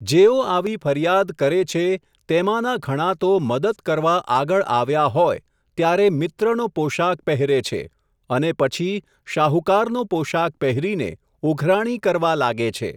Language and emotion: Gujarati, neutral